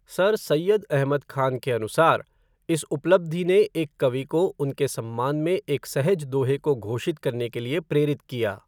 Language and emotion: Hindi, neutral